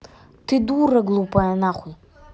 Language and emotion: Russian, angry